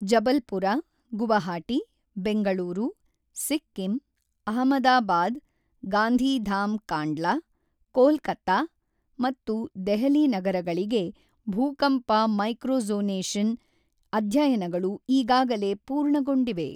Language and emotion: Kannada, neutral